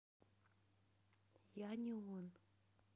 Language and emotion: Russian, neutral